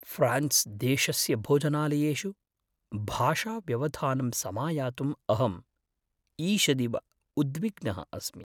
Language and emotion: Sanskrit, fearful